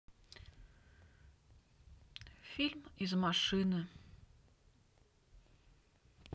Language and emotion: Russian, sad